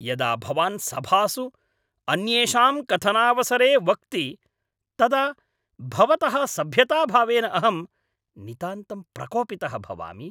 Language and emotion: Sanskrit, angry